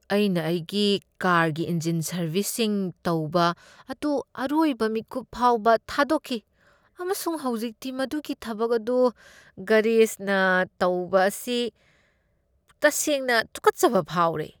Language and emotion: Manipuri, disgusted